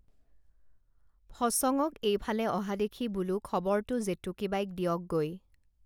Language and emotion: Assamese, neutral